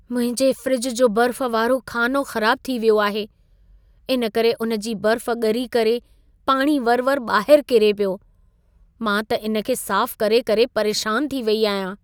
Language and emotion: Sindhi, sad